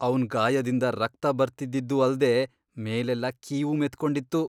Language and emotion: Kannada, disgusted